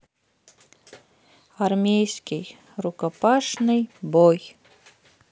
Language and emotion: Russian, sad